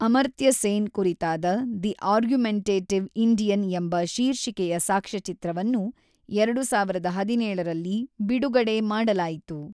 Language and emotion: Kannada, neutral